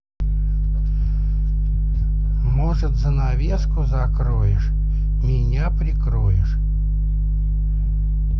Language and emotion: Russian, neutral